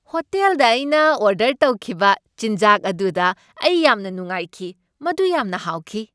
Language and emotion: Manipuri, happy